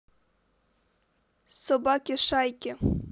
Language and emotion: Russian, neutral